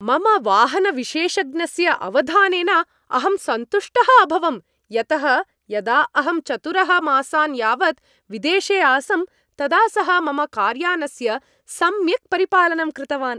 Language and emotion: Sanskrit, happy